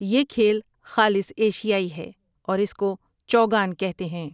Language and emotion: Urdu, neutral